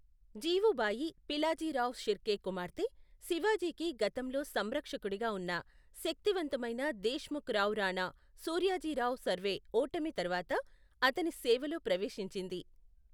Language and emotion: Telugu, neutral